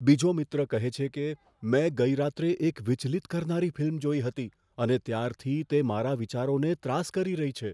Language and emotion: Gujarati, fearful